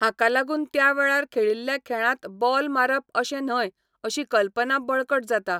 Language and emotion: Goan Konkani, neutral